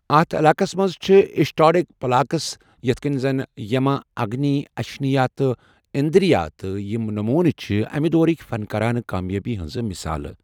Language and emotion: Kashmiri, neutral